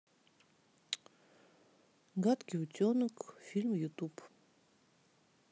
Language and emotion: Russian, neutral